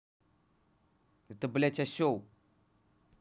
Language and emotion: Russian, angry